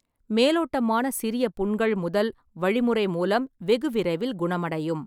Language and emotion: Tamil, neutral